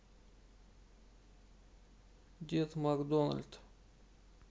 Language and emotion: Russian, sad